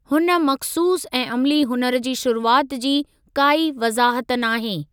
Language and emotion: Sindhi, neutral